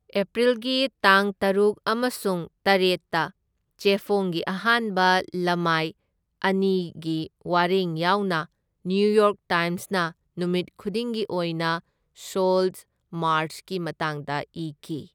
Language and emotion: Manipuri, neutral